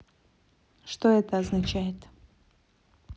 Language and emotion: Russian, neutral